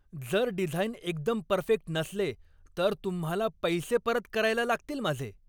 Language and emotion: Marathi, angry